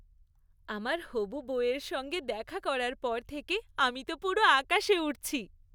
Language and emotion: Bengali, happy